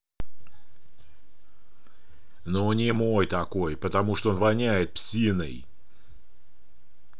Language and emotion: Russian, angry